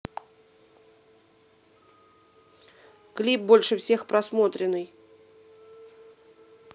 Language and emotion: Russian, neutral